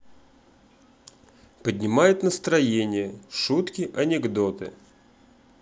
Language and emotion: Russian, positive